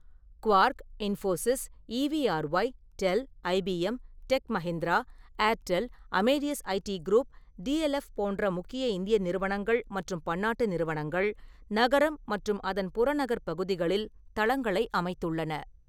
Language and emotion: Tamil, neutral